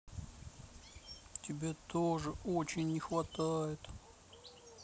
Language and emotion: Russian, sad